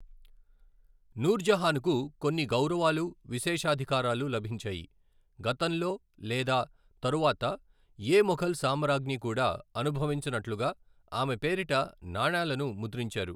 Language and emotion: Telugu, neutral